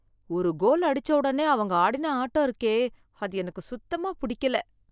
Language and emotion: Tamil, disgusted